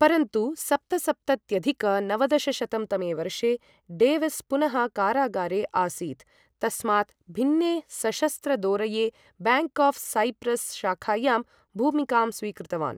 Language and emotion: Sanskrit, neutral